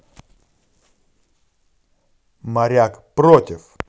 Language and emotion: Russian, angry